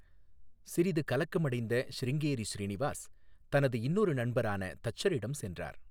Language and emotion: Tamil, neutral